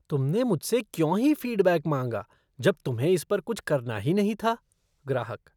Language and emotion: Hindi, disgusted